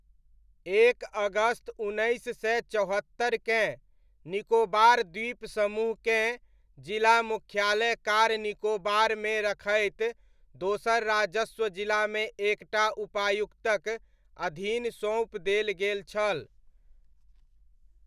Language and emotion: Maithili, neutral